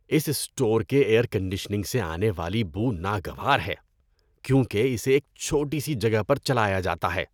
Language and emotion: Urdu, disgusted